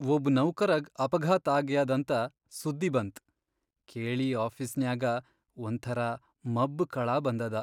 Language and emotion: Kannada, sad